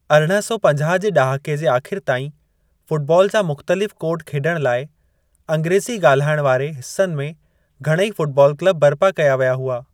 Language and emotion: Sindhi, neutral